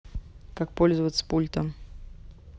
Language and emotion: Russian, neutral